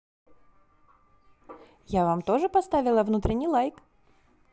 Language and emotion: Russian, positive